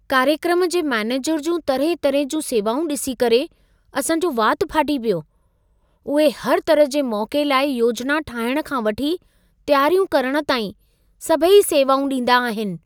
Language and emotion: Sindhi, surprised